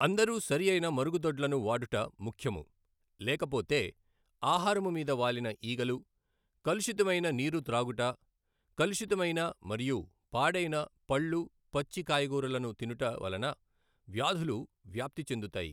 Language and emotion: Telugu, neutral